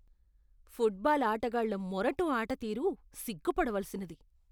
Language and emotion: Telugu, disgusted